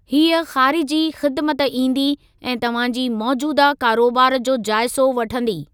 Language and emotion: Sindhi, neutral